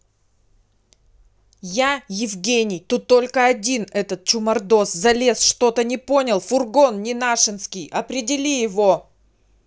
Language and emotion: Russian, angry